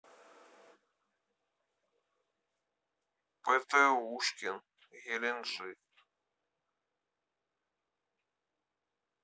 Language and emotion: Russian, neutral